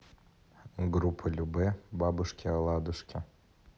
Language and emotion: Russian, neutral